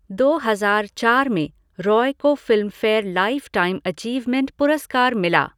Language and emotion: Hindi, neutral